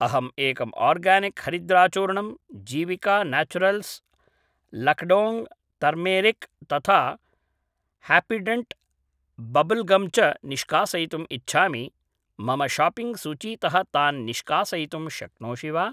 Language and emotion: Sanskrit, neutral